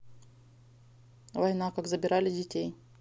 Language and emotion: Russian, neutral